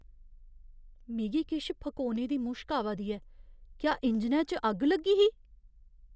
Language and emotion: Dogri, fearful